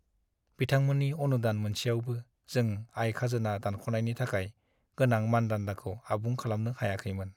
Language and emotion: Bodo, sad